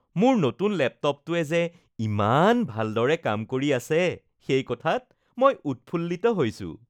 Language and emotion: Assamese, happy